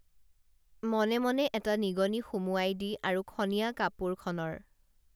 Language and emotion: Assamese, neutral